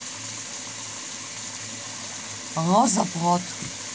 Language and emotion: Russian, angry